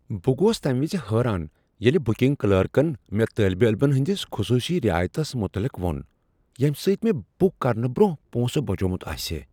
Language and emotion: Kashmiri, surprised